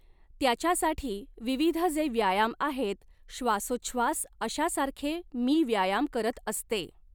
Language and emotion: Marathi, neutral